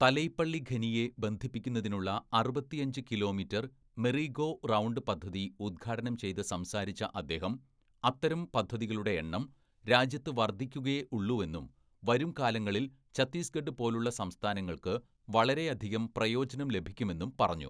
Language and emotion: Malayalam, neutral